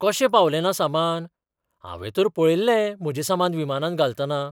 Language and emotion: Goan Konkani, surprised